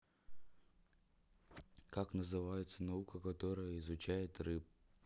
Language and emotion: Russian, neutral